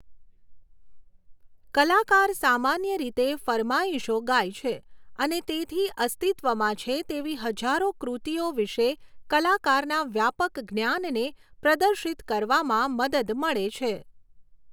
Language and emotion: Gujarati, neutral